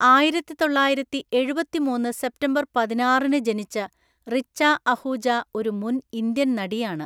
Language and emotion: Malayalam, neutral